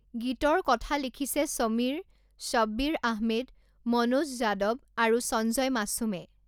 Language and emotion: Assamese, neutral